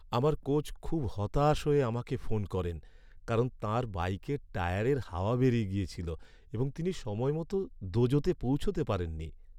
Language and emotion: Bengali, sad